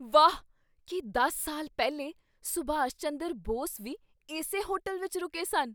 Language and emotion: Punjabi, surprised